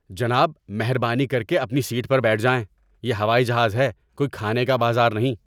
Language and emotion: Urdu, angry